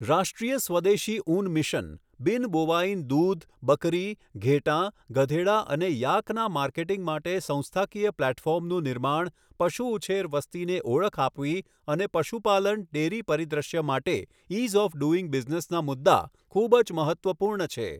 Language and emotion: Gujarati, neutral